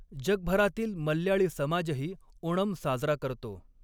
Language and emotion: Marathi, neutral